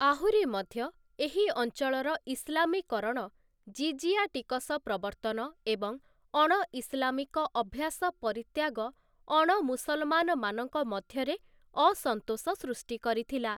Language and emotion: Odia, neutral